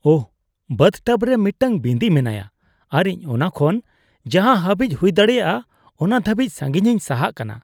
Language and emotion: Santali, disgusted